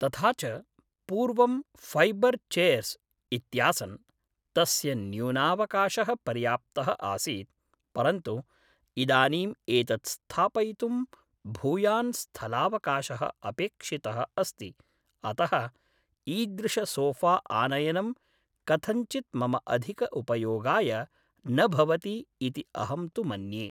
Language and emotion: Sanskrit, neutral